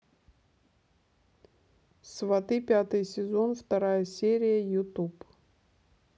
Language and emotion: Russian, neutral